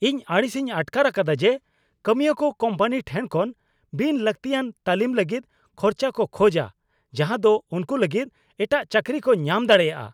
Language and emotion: Santali, angry